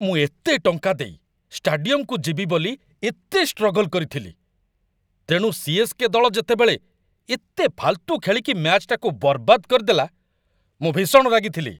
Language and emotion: Odia, angry